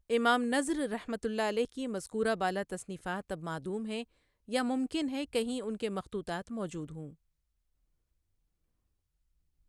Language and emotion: Urdu, neutral